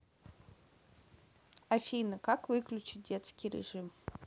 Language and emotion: Russian, neutral